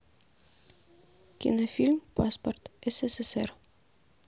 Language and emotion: Russian, neutral